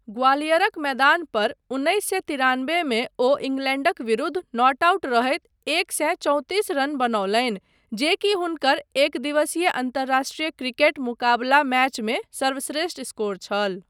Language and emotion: Maithili, neutral